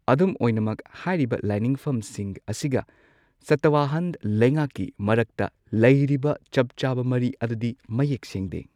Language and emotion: Manipuri, neutral